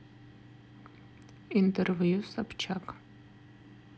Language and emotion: Russian, neutral